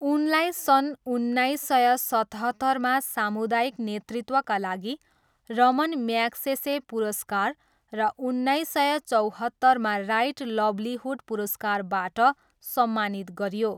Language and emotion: Nepali, neutral